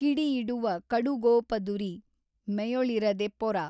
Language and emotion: Kannada, neutral